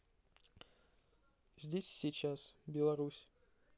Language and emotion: Russian, neutral